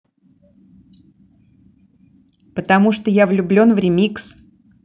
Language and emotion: Russian, neutral